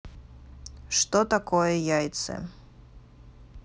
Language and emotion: Russian, neutral